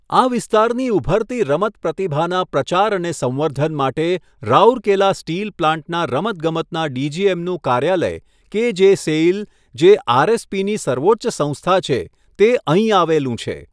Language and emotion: Gujarati, neutral